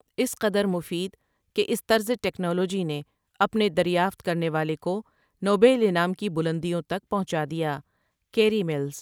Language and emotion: Urdu, neutral